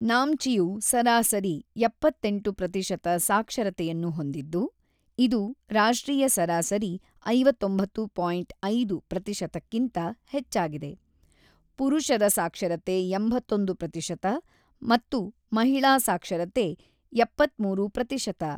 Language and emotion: Kannada, neutral